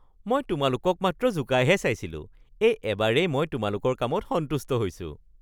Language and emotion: Assamese, happy